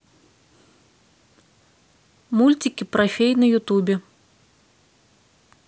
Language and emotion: Russian, neutral